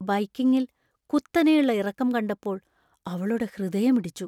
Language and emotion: Malayalam, fearful